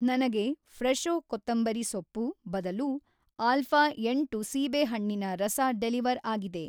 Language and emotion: Kannada, neutral